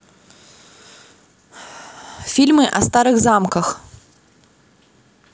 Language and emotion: Russian, neutral